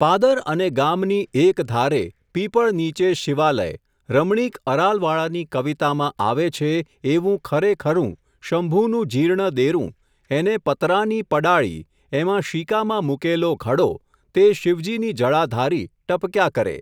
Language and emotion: Gujarati, neutral